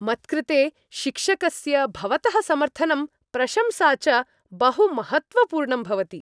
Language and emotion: Sanskrit, happy